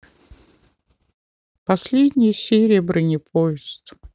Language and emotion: Russian, sad